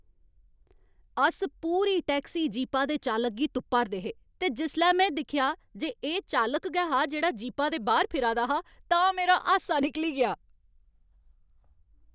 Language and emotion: Dogri, happy